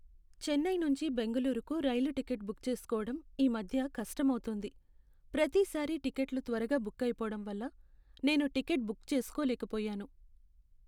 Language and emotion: Telugu, sad